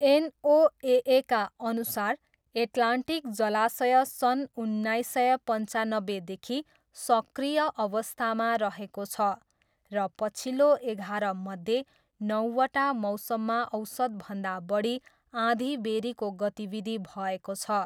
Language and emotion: Nepali, neutral